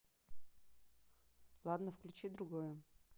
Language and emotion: Russian, neutral